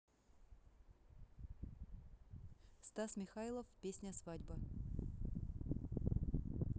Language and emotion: Russian, neutral